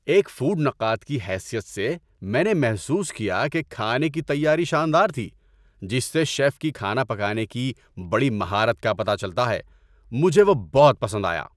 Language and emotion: Urdu, happy